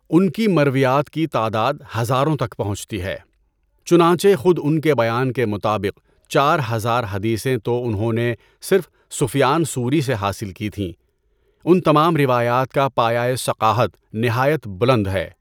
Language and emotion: Urdu, neutral